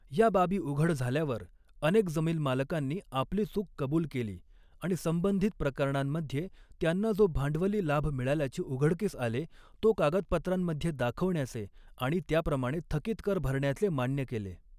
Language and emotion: Marathi, neutral